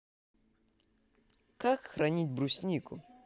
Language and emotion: Russian, positive